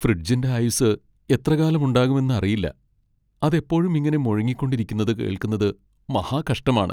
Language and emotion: Malayalam, sad